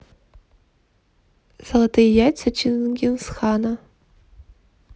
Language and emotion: Russian, neutral